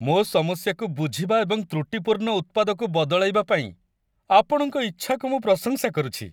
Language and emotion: Odia, happy